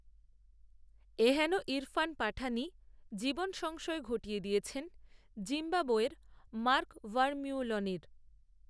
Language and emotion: Bengali, neutral